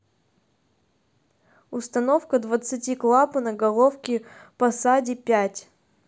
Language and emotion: Russian, neutral